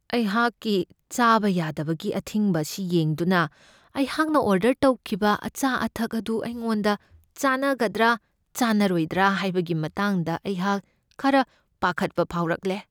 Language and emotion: Manipuri, fearful